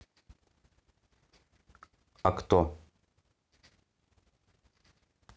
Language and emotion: Russian, neutral